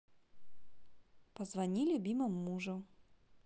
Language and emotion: Russian, positive